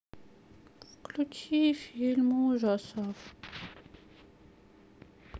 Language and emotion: Russian, sad